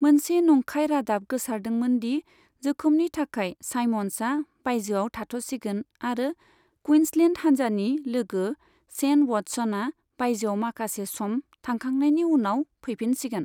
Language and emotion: Bodo, neutral